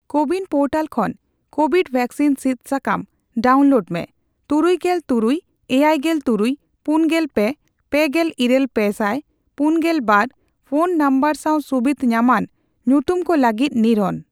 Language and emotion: Santali, neutral